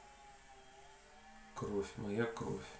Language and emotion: Russian, neutral